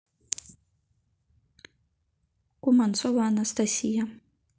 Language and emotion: Russian, neutral